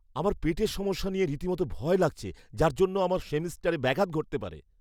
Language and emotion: Bengali, fearful